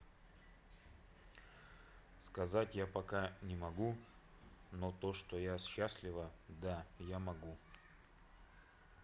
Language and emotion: Russian, neutral